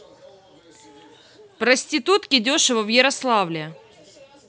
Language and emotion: Russian, neutral